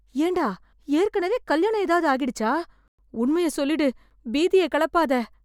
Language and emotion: Tamil, fearful